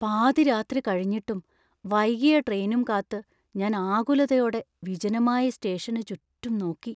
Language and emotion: Malayalam, fearful